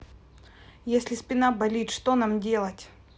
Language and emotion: Russian, neutral